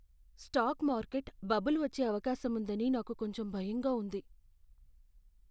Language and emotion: Telugu, fearful